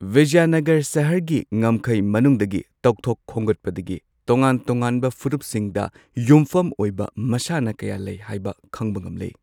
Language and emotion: Manipuri, neutral